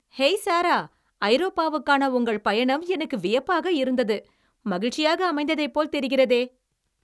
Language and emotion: Tamil, happy